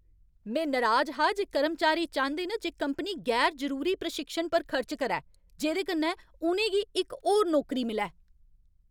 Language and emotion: Dogri, angry